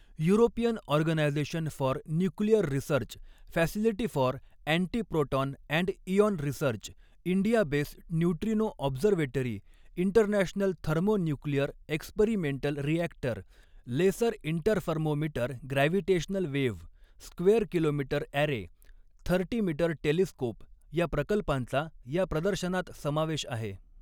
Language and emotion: Marathi, neutral